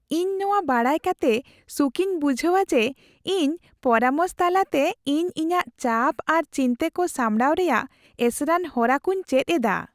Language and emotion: Santali, happy